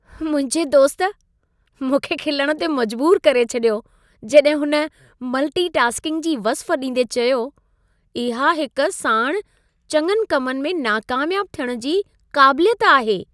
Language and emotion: Sindhi, happy